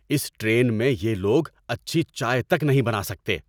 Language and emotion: Urdu, angry